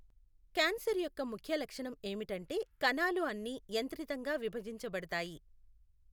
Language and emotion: Telugu, neutral